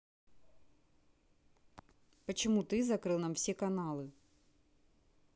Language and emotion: Russian, neutral